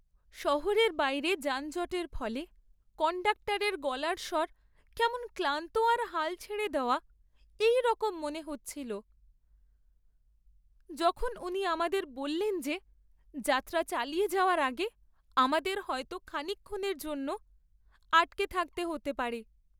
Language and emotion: Bengali, sad